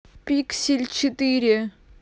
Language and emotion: Russian, neutral